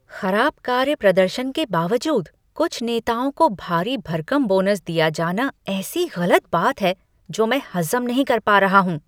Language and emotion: Hindi, disgusted